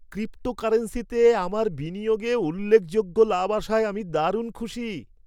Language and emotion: Bengali, happy